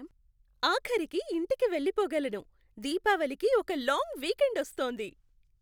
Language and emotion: Telugu, happy